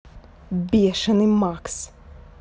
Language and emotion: Russian, angry